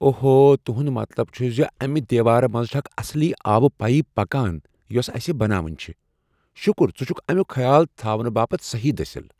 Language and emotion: Kashmiri, surprised